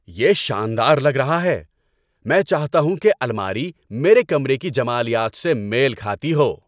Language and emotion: Urdu, happy